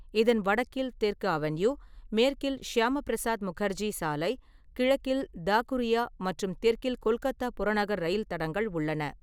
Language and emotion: Tamil, neutral